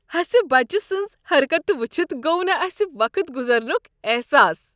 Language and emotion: Kashmiri, happy